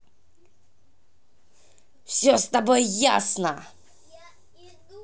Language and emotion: Russian, angry